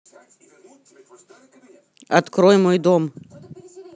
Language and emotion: Russian, angry